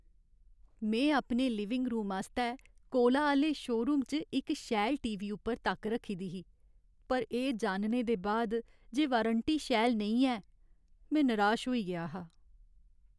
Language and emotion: Dogri, sad